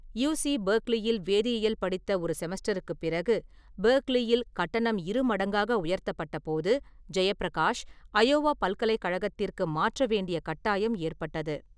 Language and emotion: Tamil, neutral